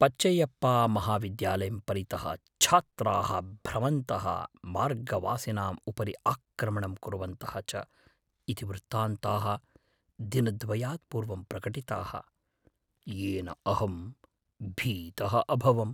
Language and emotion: Sanskrit, fearful